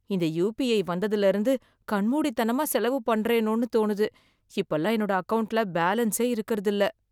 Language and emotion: Tamil, sad